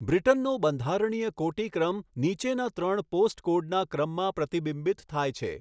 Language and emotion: Gujarati, neutral